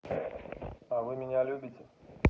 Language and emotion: Russian, neutral